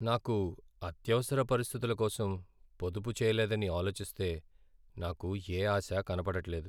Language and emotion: Telugu, sad